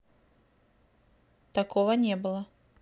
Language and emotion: Russian, neutral